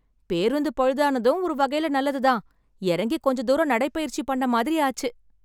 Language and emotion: Tamil, happy